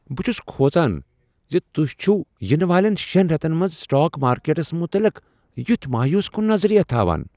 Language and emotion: Kashmiri, surprised